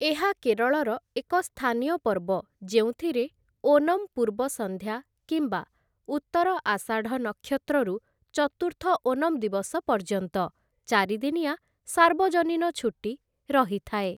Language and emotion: Odia, neutral